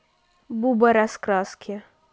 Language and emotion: Russian, neutral